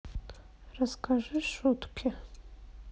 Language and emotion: Russian, sad